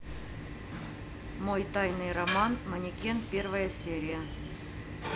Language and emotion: Russian, neutral